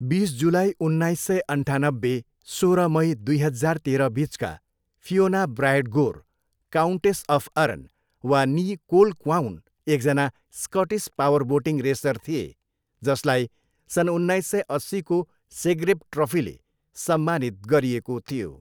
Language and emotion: Nepali, neutral